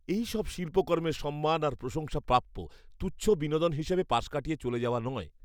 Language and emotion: Bengali, disgusted